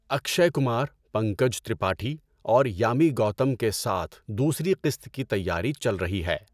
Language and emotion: Urdu, neutral